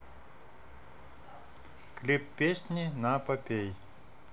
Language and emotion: Russian, neutral